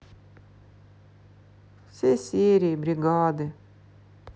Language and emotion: Russian, sad